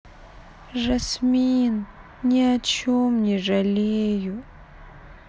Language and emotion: Russian, sad